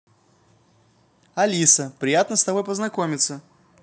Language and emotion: Russian, positive